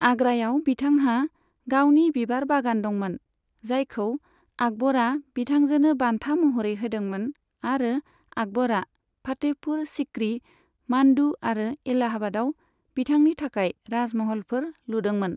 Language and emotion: Bodo, neutral